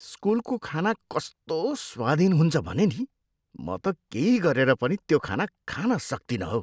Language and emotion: Nepali, disgusted